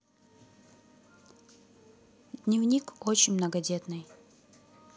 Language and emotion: Russian, neutral